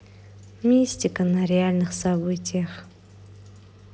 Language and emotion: Russian, neutral